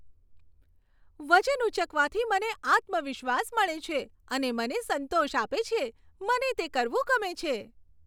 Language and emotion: Gujarati, happy